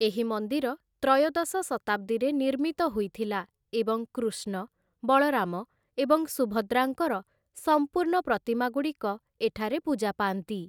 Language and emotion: Odia, neutral